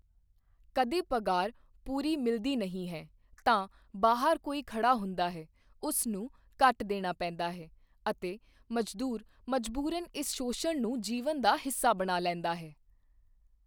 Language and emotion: Punjabi, neutral